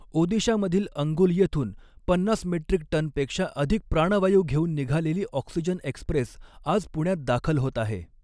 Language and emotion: Marathi, neutral